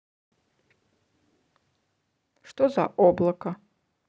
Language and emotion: Russian, neutral